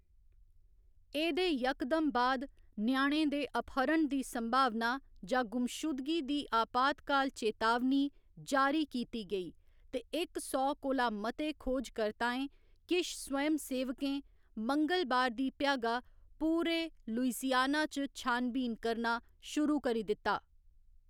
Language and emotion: Dogri, neutral